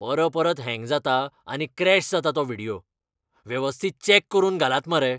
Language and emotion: Goan Konkani, angry